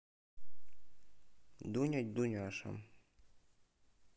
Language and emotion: Russian, neutral